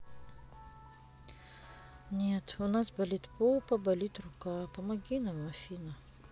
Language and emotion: Russian, sad